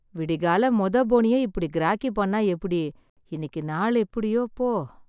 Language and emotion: Tamil, sad